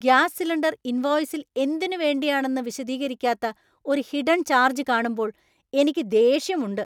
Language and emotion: Malayalam, angry